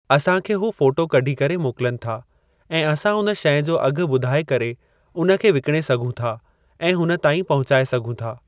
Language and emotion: Sindhi, neutral